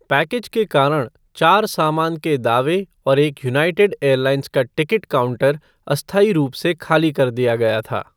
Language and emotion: Hindi, neutral